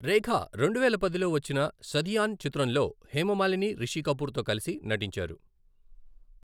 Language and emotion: Telugu, neutral